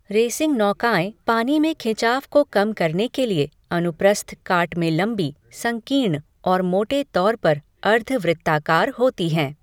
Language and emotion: Hindi, neutral